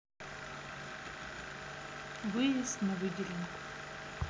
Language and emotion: Russian, neutral